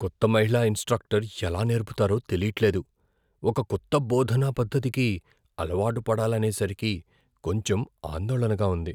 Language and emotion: Telugu, fearful